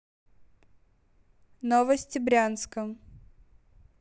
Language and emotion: Russian, neutral